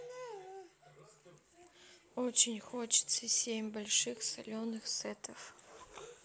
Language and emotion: Russian, sad